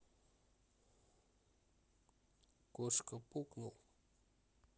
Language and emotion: Russian, neutral